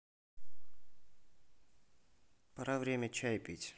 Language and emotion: Russian, neutral